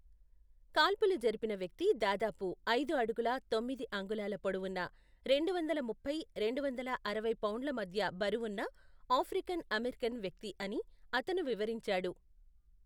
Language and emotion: Telugu, neutral